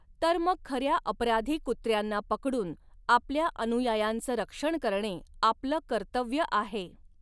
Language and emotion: Marathi, neutral